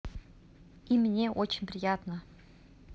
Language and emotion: Russian, positive